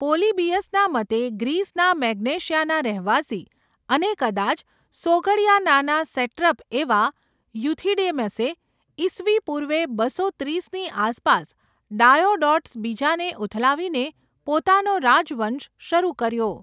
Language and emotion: Gujarati, neutral